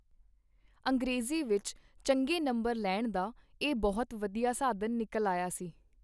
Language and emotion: Punjabi, neutral